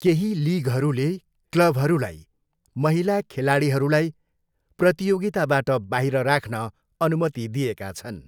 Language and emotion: Nepali, neutral